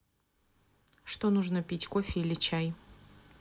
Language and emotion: Russian, neutral